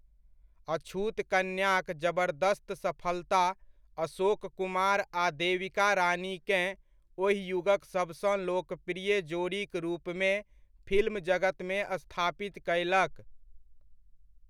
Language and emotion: Maithili, neutral